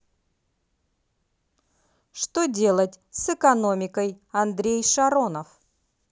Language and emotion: Russian, positive